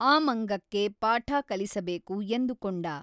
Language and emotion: Kannada, neutral